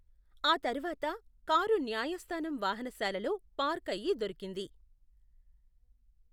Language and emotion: Telugu, neutral